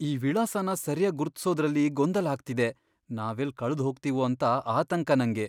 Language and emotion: Kannada, fearful